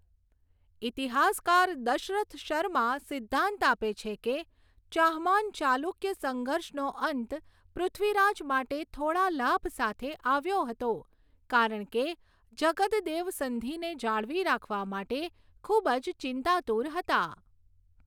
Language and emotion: Gujarati, neutral